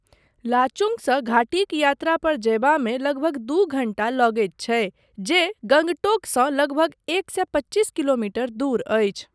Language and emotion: Maithili, neutral